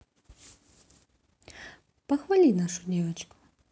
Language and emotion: Russian, neutral